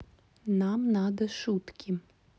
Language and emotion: Russian, neutral